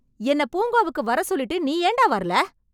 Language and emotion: Tamil, angry